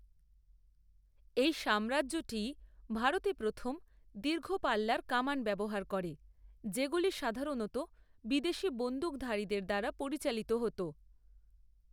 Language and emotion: Bengali, neutral